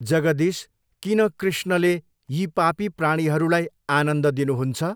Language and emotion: Nepali, neutral